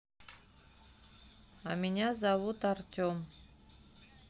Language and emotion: Russian, neutral